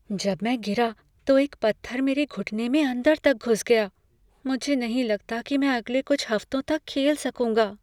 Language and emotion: Hindi, fearful